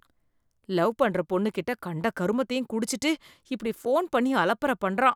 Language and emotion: Tamil, disgusted